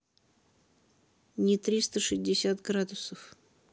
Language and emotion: Russian, neutral